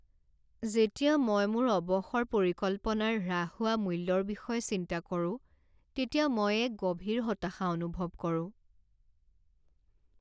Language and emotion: Assamese, sad